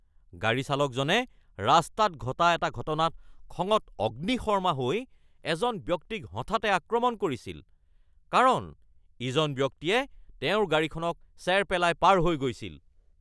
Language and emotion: Assamese, angry